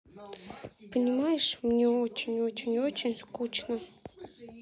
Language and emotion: Russian, sad